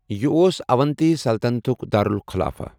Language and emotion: Kashmiri, neutral